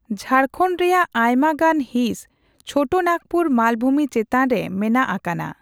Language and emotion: Santali, neutral